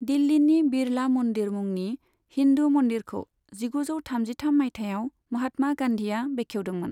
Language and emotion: Bodo, neutral